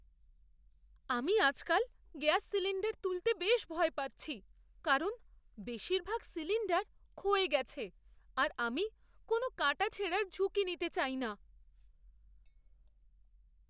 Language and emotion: Bengali, fearful